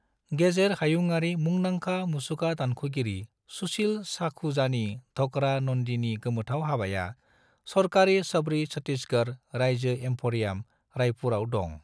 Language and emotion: Bodo, neutral